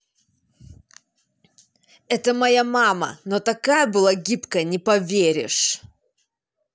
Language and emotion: Russian, angry